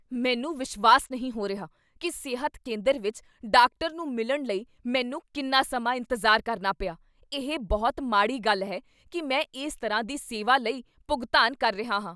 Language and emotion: Punjabi, angry